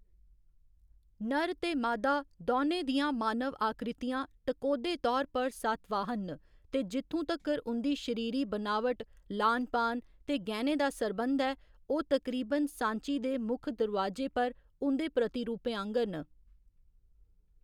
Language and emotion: Dogri, neutral